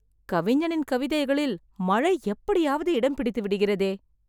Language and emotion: Tamil, surprised